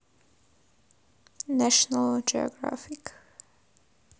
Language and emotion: Russian, neutral